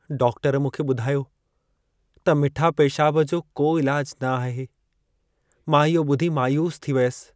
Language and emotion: Sindhi, sad